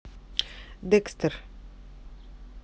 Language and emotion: Russian, neutral